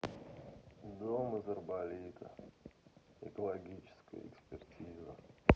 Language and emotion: Russian, sad